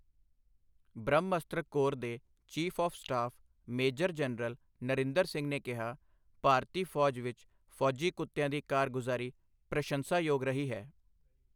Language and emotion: Punjabi, neutral